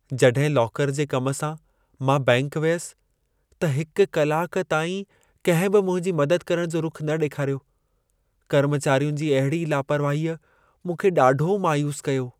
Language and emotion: Sindhi, sad